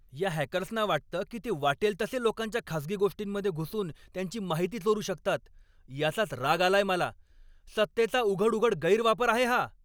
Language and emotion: Marathi, angry